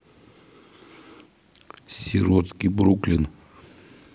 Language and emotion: Russian, neutral